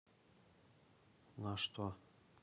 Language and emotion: Russian, neutral